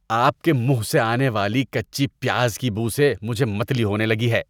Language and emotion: Urdu, disgusted